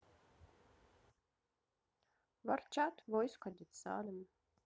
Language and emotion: Russian, neutral